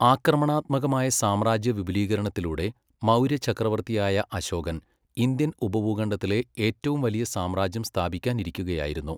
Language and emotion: Malayalam, neutral